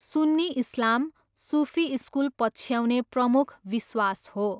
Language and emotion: Nepali, neutral